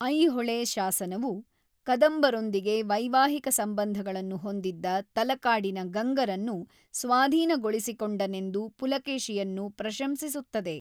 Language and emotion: Kannada, neutral